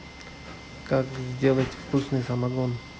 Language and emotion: Russian, neutral